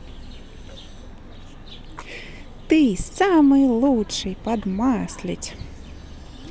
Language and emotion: Russian, positive